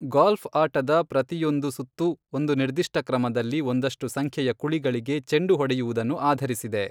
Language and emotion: Kannada, neutral